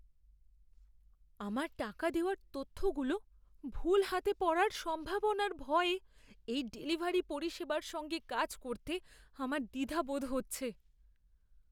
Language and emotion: Bengali, fearful